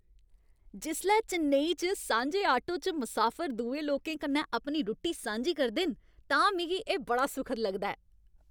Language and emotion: Dogri, happy